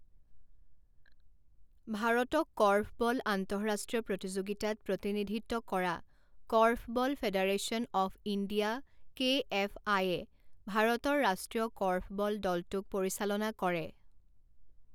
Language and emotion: Assamese, neutral